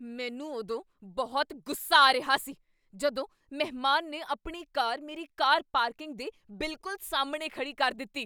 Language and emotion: Punjabi, angry